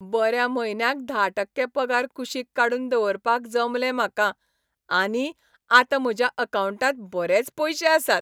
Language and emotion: Goan Konkani, happy